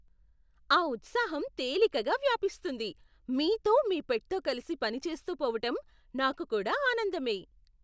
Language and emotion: Telugu, surprised